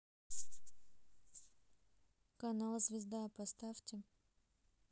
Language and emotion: Russian, neutral